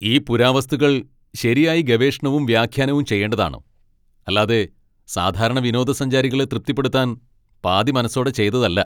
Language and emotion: Malayalam, angry